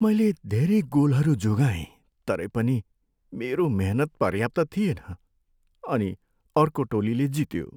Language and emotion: Nepali, sad